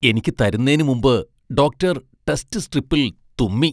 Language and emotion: Malayalam, disgusted